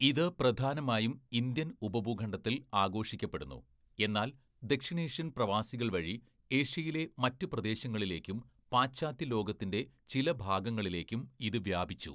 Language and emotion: Malayalam, neutral